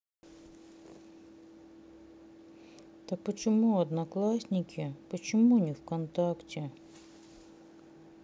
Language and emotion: Russian, sad